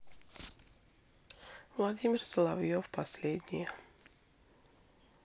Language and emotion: Russian, sad